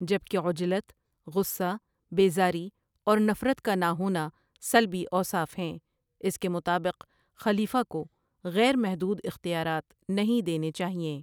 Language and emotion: Urdu, neutral